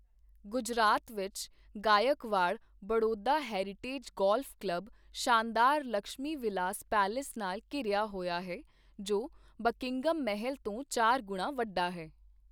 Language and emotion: Punjabi, neutral